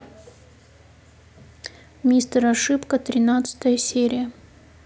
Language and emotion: Russian, neutral